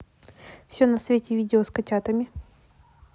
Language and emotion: Russian, neutral